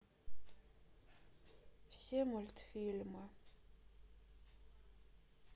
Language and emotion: Russian, sad